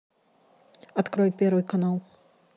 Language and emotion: Russian, neutral